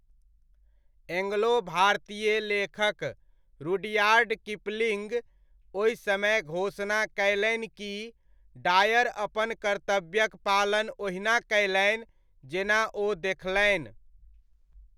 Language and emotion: Maithili, neutral